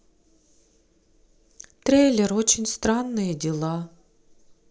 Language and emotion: Russian, sad